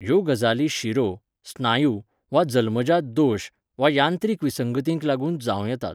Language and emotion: Goan Konkani, neutral